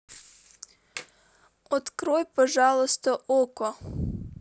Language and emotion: Russian, neutral